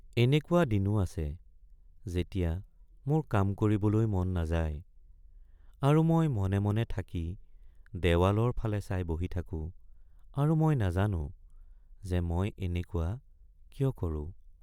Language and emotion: Assamese, sad